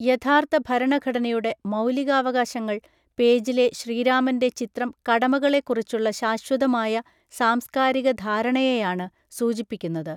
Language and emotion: Malayalam, neutral